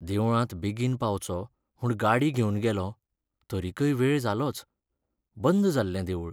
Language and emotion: Goan Konkani, sad